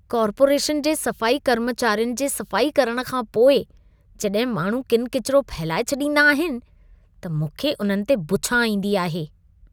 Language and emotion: Sindhi, disgusted